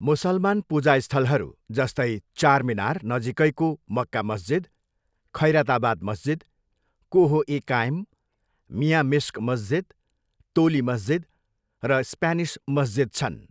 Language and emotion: Nepali, neutral